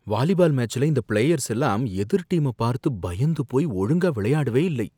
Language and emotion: Tamil, fearful